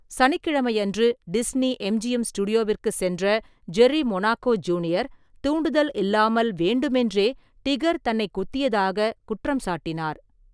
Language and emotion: Tamil, neutral